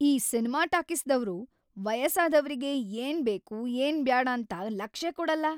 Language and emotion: Kannada, angry